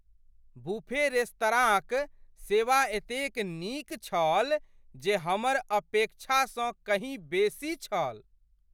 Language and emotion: Maithili, surprised